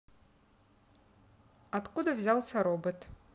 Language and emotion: Russian, neutral